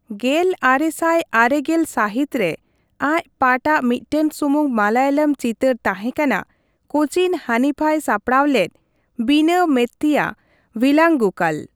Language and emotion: Santali, neutral